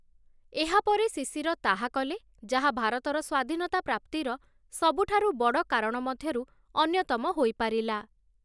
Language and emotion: Odia, neutral